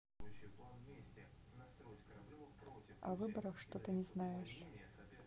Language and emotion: Russian, neutral